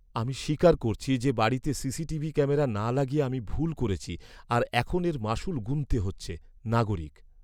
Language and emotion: Bengali, sad